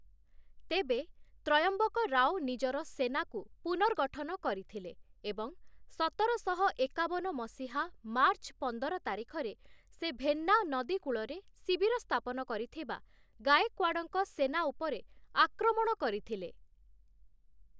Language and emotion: Odia, neutral